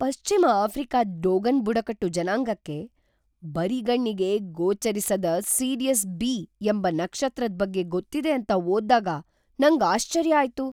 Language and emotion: Kannada, surprised